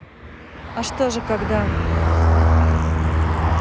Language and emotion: Russian, neutral